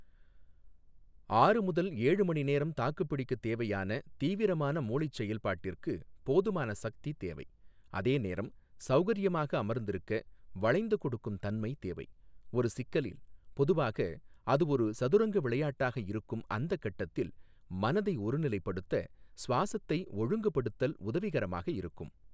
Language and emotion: Tamil, neutral